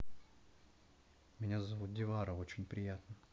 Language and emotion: Russian, neutral